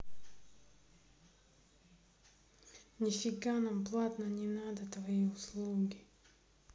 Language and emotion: Russian, angry